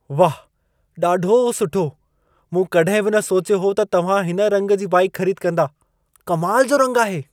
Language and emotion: Sindhi, surprised